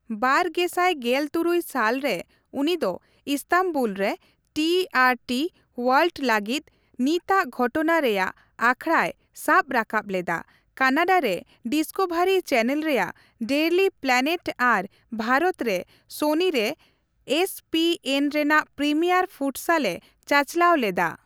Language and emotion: Santali, neutral